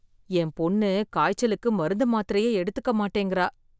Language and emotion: Tamil, fearful